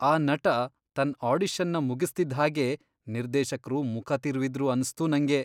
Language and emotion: Kannada, disgusted